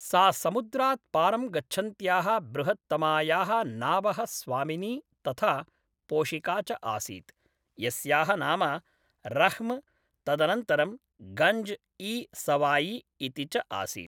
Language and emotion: Sanskrit, neutral